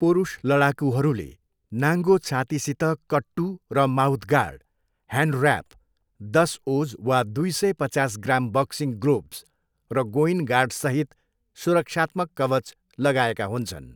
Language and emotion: Nepali, neutral